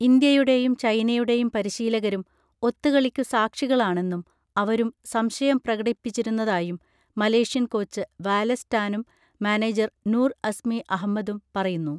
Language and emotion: Malayalam, neutral